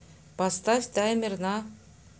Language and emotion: Russian, neutral